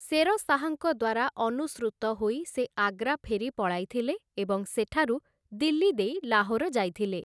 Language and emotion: Odia, neutral